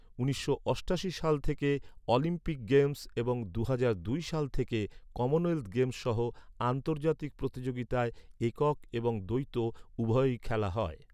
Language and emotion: Bengali, neutral